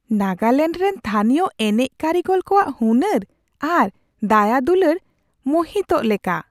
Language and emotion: Santali, surprised